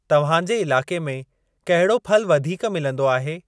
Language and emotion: Sindhi, neutral